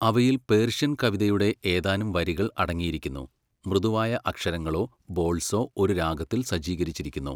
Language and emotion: Malayalam, neutral